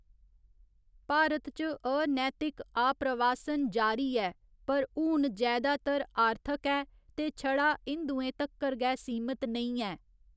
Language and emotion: Dogri, neutral